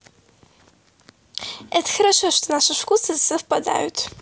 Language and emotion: Russian, positive